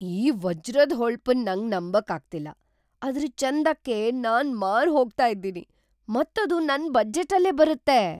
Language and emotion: Kannada, surprised